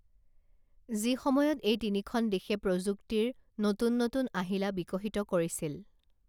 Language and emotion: Assamese, neutral